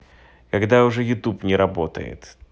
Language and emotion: Russian, neutral